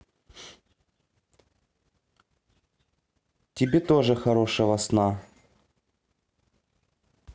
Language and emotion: Russian, positive